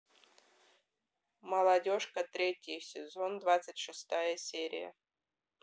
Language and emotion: Russian, neutral